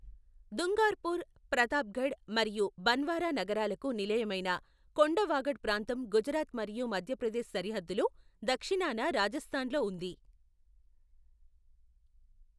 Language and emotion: Telugu, neutral